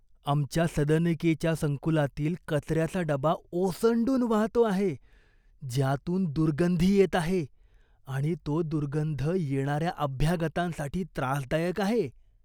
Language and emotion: Marathi, disgusted